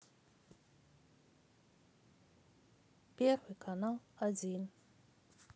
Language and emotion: Russian, neutral